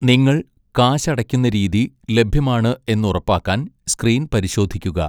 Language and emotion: Malayalam, neutral